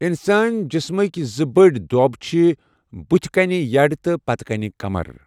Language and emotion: Kashmiri, neutral